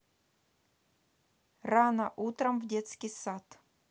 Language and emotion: Russian, neutral